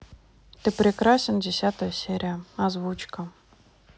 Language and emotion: Russian, neutral